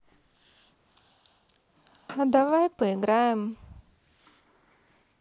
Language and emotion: Russian, sad